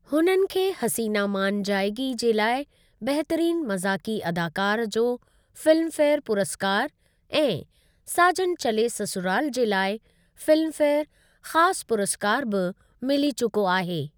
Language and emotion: Sindhi, neutral